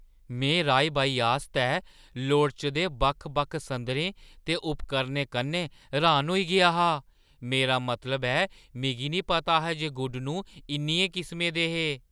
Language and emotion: Dogri, surprised